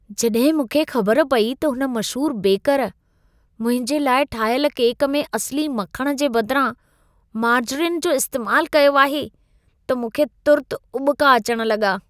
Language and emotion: Sindhi, disgusted